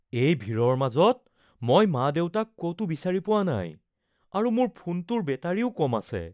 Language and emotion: Assamese, fearful